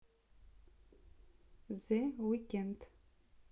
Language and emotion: Russian, neutral